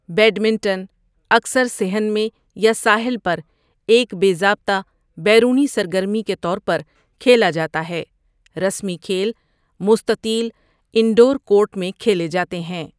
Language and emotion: Urdu, neutral